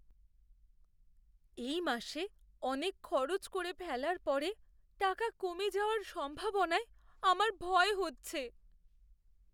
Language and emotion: Bengali, fearful